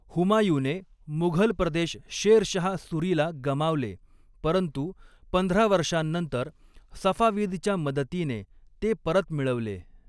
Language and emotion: Marathi, neutral